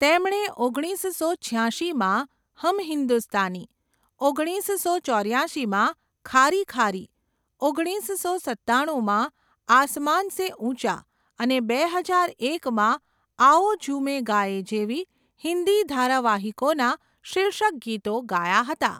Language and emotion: Gujarati, neutral